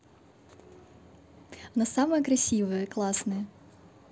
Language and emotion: Russian, positive